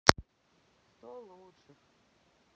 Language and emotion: Russian, sad